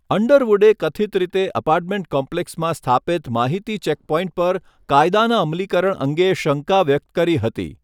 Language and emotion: Gujarati, neutral